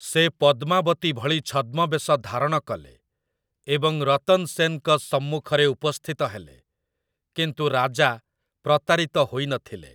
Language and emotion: Odia, neutral